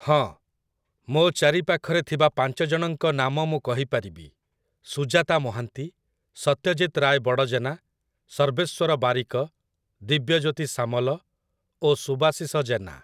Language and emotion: Odia, neutral